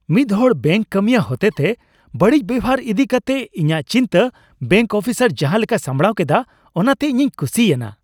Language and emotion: Santali, happy